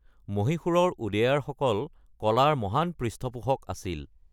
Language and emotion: Assamese, neutral